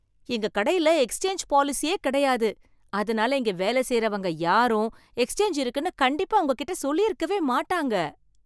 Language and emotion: Tamil, surprised